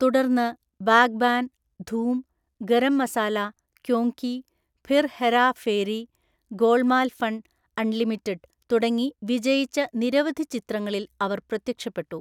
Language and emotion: Malayalam, neutral